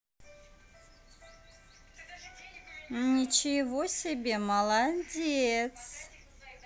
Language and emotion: Russian, positive